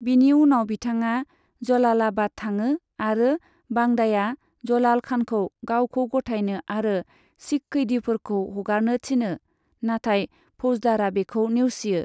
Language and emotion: Bodo, neutral